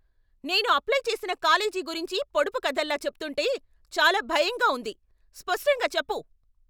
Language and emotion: Telugu, angry